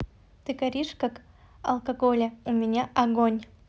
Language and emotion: Russian, neutral